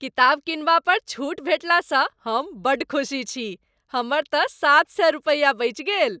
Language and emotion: Maithili, happy